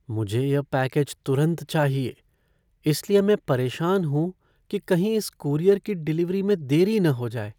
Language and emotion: Hindi, fearful